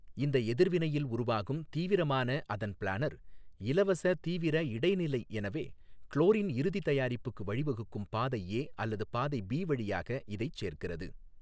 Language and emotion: Tamil, neutral